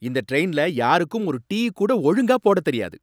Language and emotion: Tamil, angry